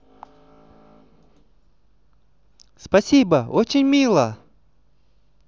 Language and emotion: Russian, positive